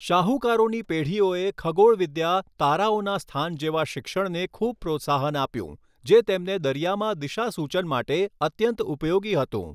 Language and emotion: Gujarati, neutral